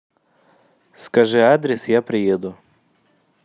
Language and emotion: Russian, neutral